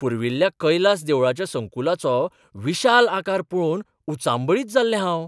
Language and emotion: Goan Konkani, surprised